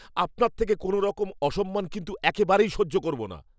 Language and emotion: Bengali, angry